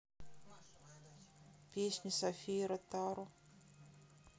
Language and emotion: Russian, sad